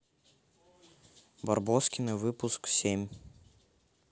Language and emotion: Russian, neutral